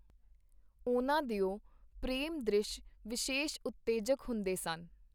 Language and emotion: Punjabi, neutral